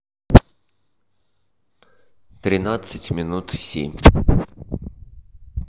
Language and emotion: Russian, neutral